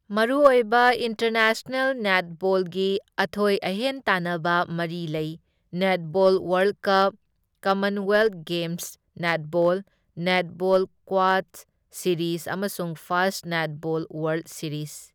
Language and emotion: Manipuri, neutral